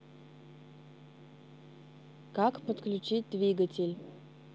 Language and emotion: Russian, neutral